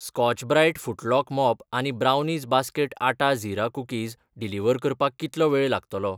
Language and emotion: Goan Konkani, neutral